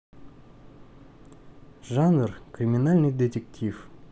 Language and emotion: Russian, neutral